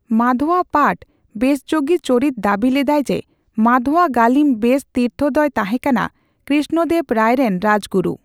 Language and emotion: Santali, neutral